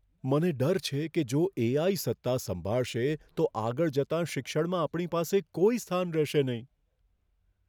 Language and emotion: Gujarati, fearful